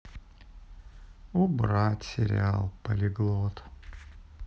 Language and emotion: Russian, sad